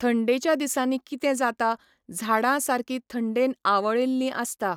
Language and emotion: Goan Konkani, neutral